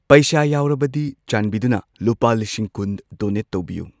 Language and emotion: Manipuri, neutral